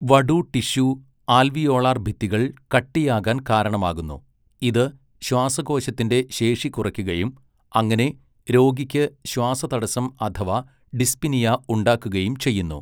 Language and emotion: Malayalam, neutral